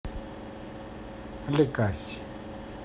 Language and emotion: Russian, neutral